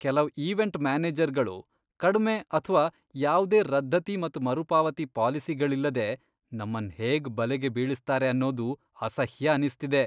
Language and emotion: Kannada, disgusted